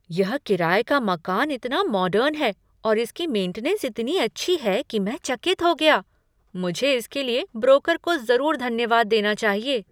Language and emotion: Hindi, surprised